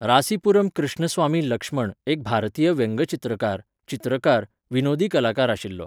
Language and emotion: Goan Konkani, neutral